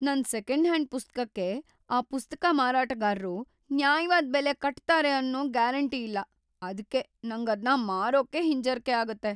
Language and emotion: Kannada, fearful